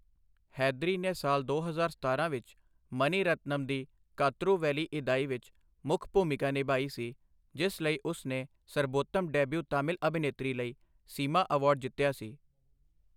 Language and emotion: Punjabi, neutral